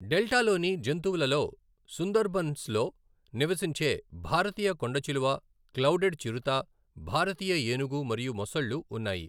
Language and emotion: Telugu, neutral